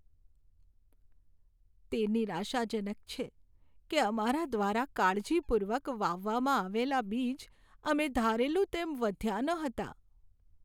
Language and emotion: Gujarati, sad